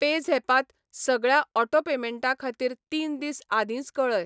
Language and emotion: Goan Konkani, neutral